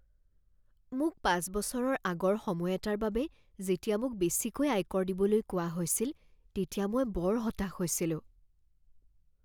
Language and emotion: Assamese, fearful